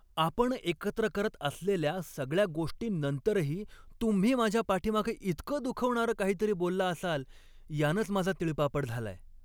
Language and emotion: Marathi, angry